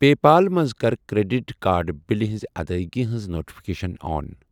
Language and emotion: Kashmiri, neutral